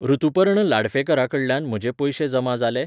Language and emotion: Goan Konkani, neutral